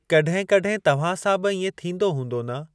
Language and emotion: Sindhi, neutral